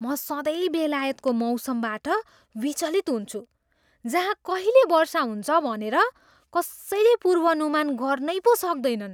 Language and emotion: Nepali, surprised